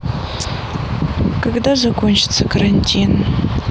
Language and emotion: Russian, sad